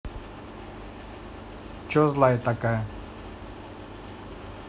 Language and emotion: Russian, neutral